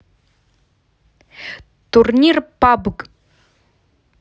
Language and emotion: Russian, neutral